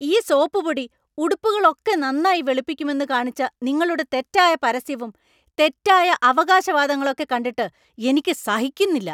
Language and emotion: Malayalam, angry